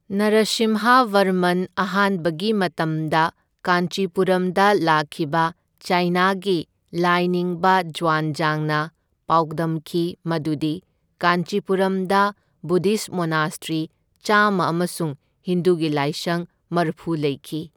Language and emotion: Manipuri, neutral